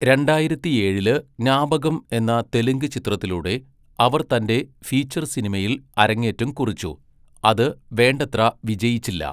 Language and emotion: Malayalam, neutral